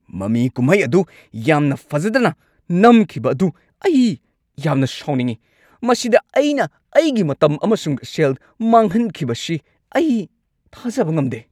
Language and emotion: Manipuri, angry